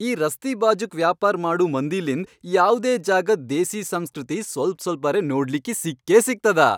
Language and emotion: Kannada, happy